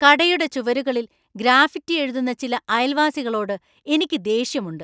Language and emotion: Malayalam, angry